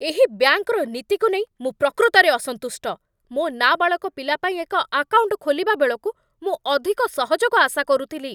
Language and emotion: Odia, angry